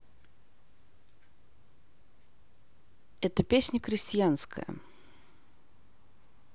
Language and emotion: Russian, neutral